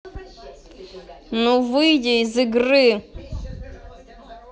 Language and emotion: Russian, angry